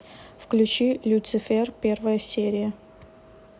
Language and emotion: Russian, neutral